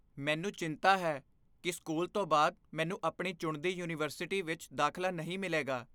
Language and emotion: Punjabi, fearful